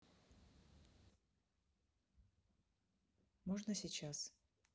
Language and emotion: Russian, neutral